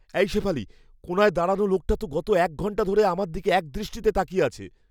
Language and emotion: Bengali, fearful